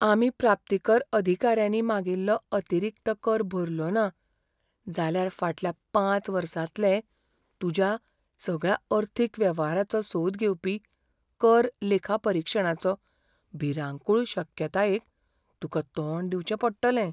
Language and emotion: Goan Konkani, fearful